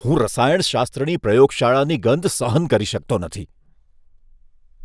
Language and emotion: Gujarati, disgusted